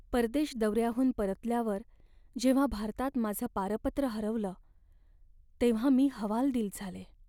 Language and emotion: Marathi, sad